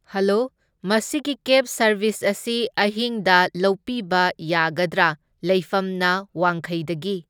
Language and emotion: Manipuri, neutral